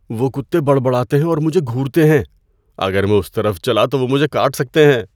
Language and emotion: Urdu, fearful